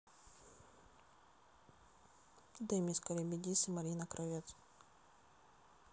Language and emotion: Russian, neutral